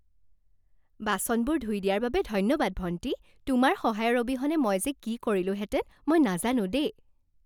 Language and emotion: Assamese, happy